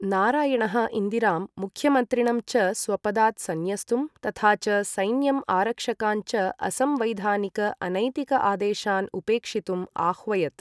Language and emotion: Sanskrit, neutral